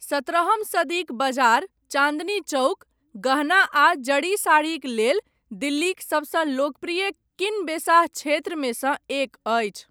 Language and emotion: Maithili, neutral